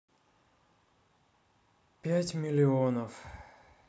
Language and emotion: Russian, sad